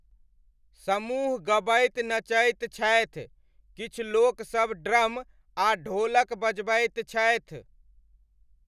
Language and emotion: Maithili, neutral